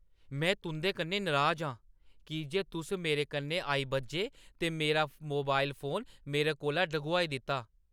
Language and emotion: Dogri, angry